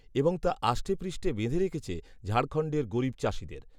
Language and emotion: Bengali, neutral